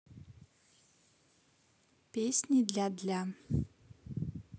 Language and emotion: Russian, neutral